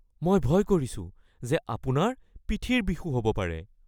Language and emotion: Assamese, fearful